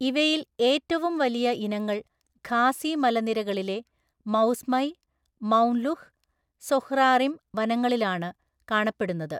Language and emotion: Malayalam, neutral